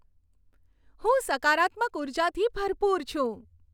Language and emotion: Gujarati, happy